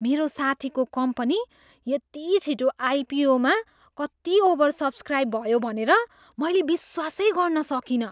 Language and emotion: Nepali, surprised